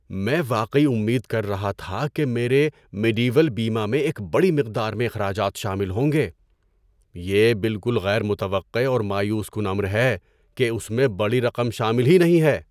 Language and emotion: Urdu, surprised